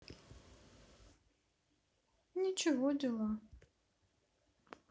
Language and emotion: Russian, sad